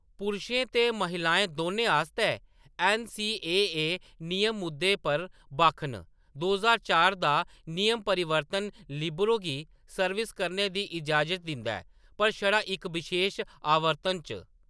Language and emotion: Dogri, neutral